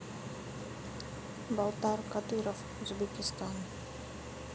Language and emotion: Russian, neutral